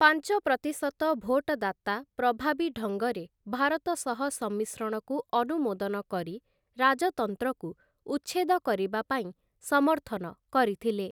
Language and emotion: Odia, neutral